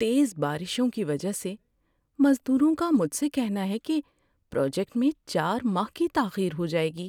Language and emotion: Urdu, sad